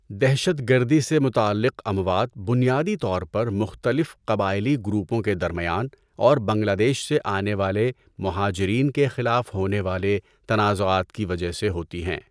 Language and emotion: Urdu, neutral